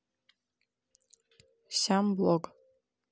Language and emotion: Russian, neutral